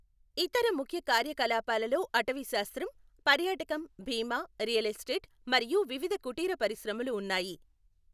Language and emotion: Telugu, neutral